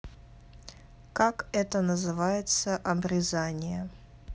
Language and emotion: Russian, neutral